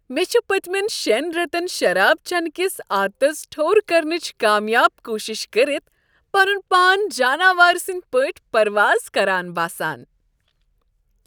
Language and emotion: Kashmiri, happy